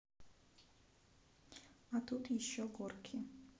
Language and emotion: Russian, neutral